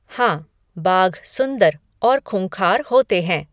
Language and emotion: Hindi, neutral